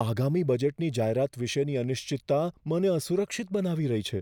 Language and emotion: Gujarati, fearful